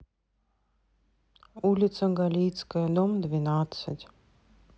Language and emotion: Russian, neutral